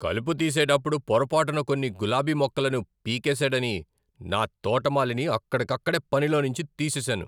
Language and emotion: Telugu, angry